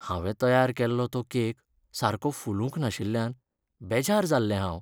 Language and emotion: Goan Konkani, sad